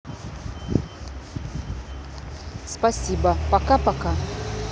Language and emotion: Russian, neutral